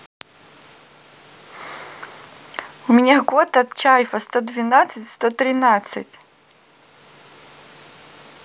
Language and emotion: Russian, positive